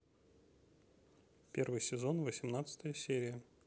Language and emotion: Russian, neutral